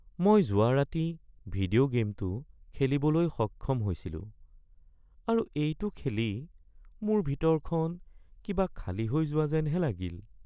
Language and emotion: Assamese, sad